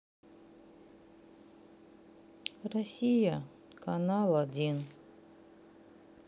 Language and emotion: Russian, sad